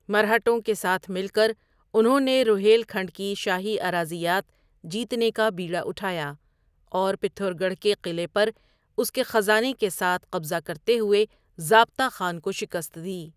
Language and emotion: Urdu, neutral